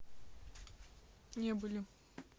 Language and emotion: Russian, neutral